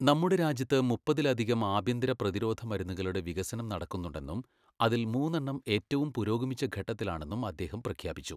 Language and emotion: Malayalam, neutral